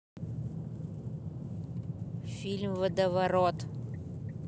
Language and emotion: Russian, angry